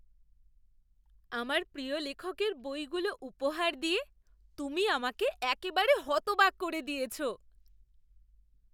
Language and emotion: Bengali, surprised